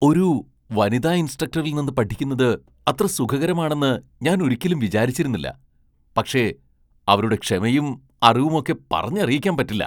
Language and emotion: Malayalam, surprised